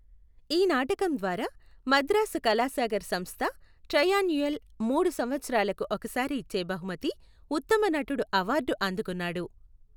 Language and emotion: Telugu, neutral